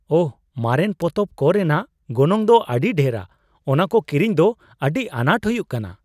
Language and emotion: Santali, surprised